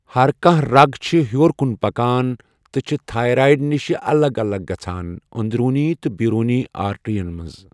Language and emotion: Kashmiri, neutral